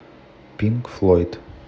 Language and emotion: Russian, neutral